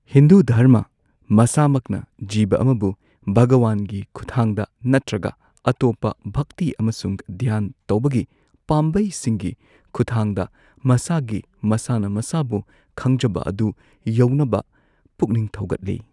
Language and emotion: Manipuri, neutral